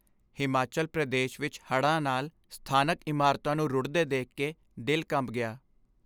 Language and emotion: Punjabi, sad